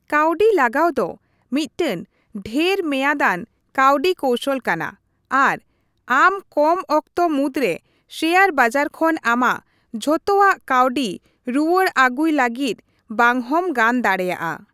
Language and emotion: Santali, neutral